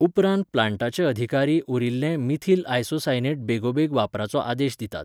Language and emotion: Goan Konkani, neutral